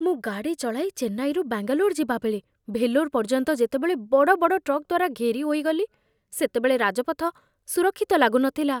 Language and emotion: Odia, fearful